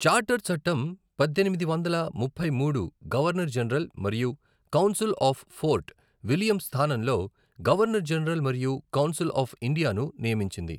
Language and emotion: Telugu, neutral